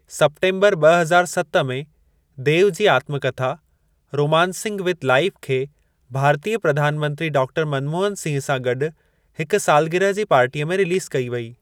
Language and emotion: Sindhi, neutral